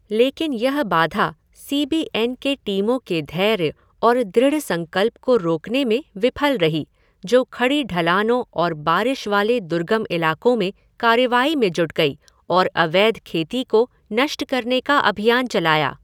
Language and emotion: Hindi, neutral